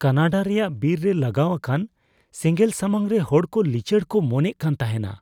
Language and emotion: Santali, fearful